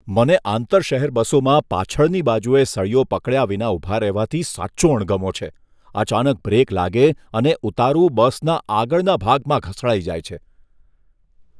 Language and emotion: Gujarati, disgusted